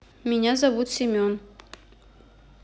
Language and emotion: Russian, neutral